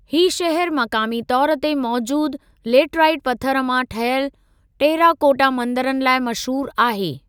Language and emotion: Sindhi, neutral